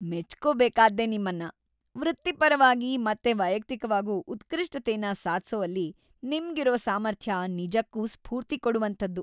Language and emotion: Kannada, happy